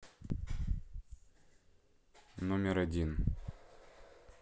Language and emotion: Russian, neutral